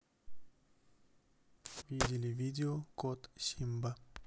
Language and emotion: Russian, neutral